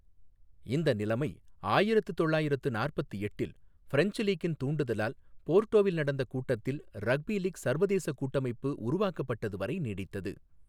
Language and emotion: Tamil, neutral